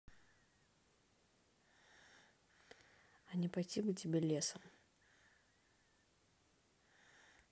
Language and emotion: Russian, angry